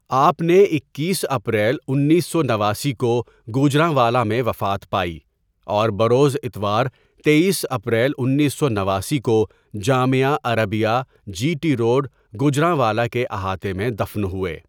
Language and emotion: Urdu, neutral